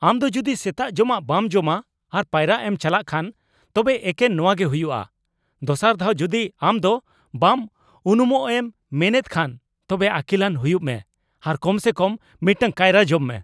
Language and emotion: Santali, angry